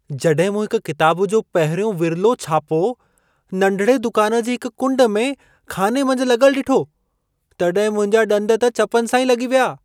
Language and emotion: Sindhi, surprised